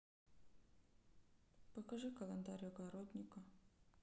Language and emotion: Russian, sad